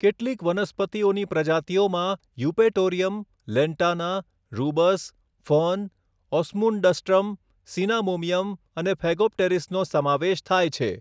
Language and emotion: Gujarati, neutral